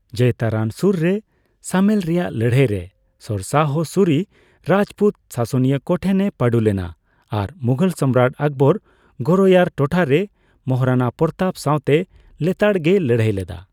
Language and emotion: Santali, neutral